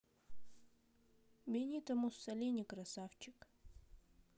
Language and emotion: Russian, neutral